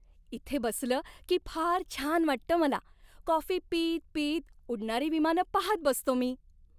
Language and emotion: Marathi, happy